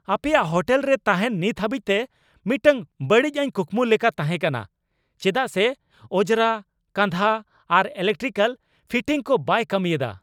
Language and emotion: Santali, angry